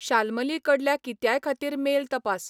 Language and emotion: Goan Konkani, neutral